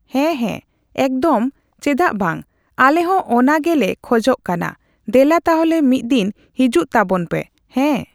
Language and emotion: Santali, neutral